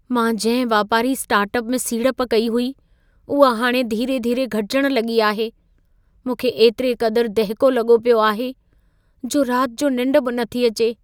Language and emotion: Sindhi, fearful